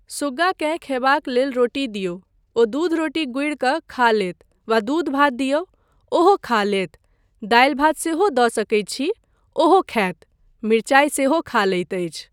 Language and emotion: Maithili, neutral